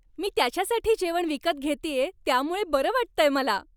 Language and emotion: Marathi, happy